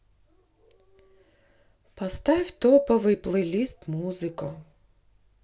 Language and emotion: Russian, sad